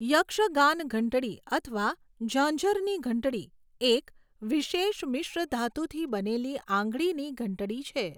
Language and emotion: Gujarati, neutral